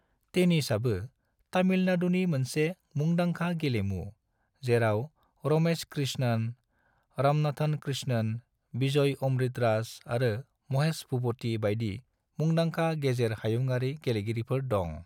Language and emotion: Bodo, neutral